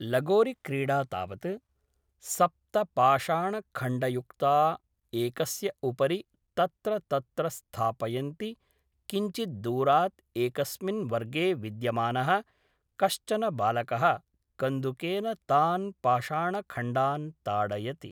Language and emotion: Sanskrit, neutral